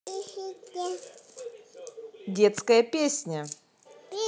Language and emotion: Russian, positive